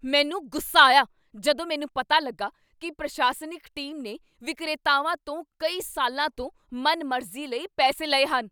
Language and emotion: Punjabi, angry